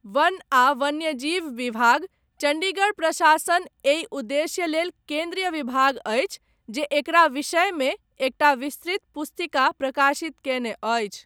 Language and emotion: Maithili, neutral